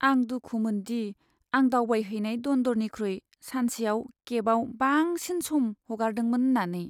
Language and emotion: Bodo, sad